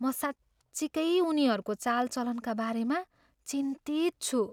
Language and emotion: Nepali, fearful